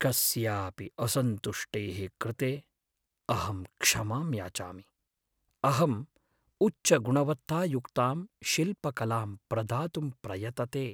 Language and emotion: Sanskrit, sad